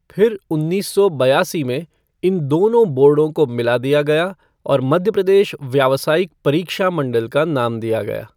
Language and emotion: Hindi, neutral